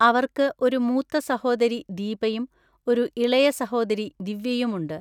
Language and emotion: Malayalam, neutral